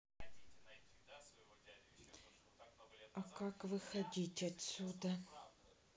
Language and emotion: Russian, sad